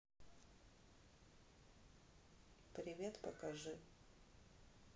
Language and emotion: Russian, neutral